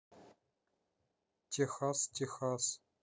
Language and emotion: Russian, neutral